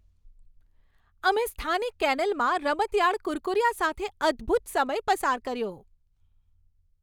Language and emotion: Gujarati, happy